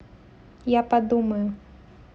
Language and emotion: Russian, neutral